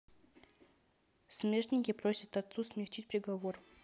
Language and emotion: Russian, neutral